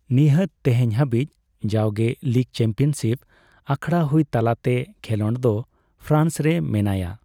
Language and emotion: Santali, neutral